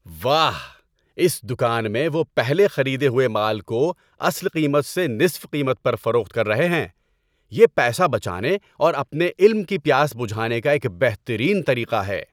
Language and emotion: Urdu, happy